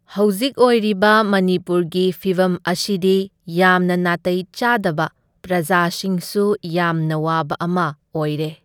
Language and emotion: Manipuri, neutral